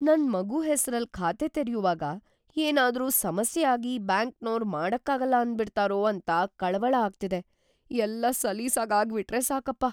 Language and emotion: Kannada, fearful